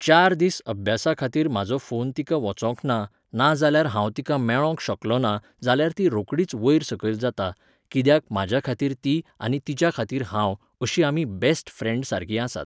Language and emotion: Goan Konkani, neutral